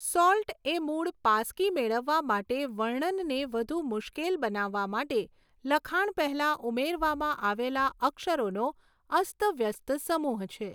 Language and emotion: Gujarati, neutral